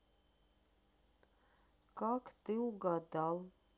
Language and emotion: Russian, neutral